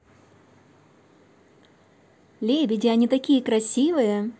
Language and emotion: Russian, positive